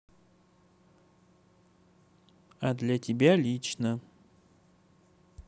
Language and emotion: Russian, neutral